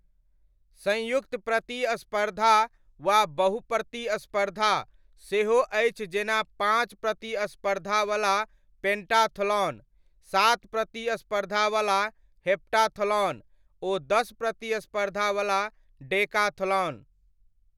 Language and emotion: Maithili, neutral